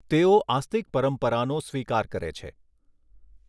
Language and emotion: Gujarati, neutral